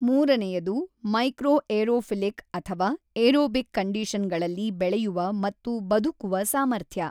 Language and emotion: Kannada, neutral